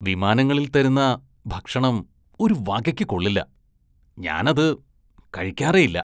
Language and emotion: Malayalam, disgusted